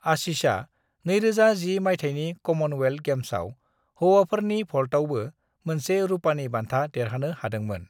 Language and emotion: Bodo, neutral